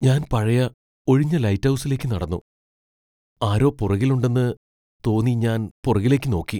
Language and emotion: Malayalam, fearful